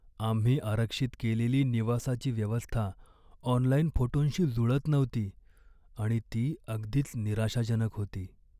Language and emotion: Marathi, sad